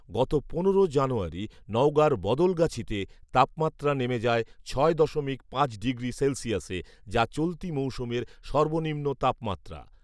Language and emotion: Bengali, neutral